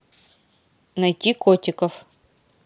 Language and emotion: Russian, neutral